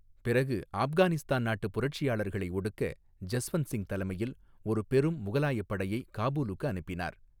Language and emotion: Tamil, neutral